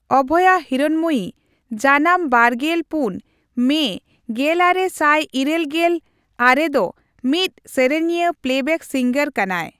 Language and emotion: Santali, neutral